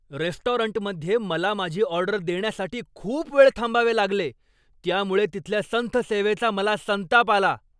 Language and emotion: Marathi, angry